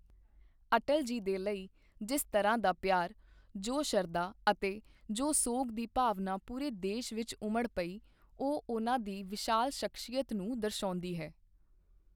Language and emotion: Punjabi, neutral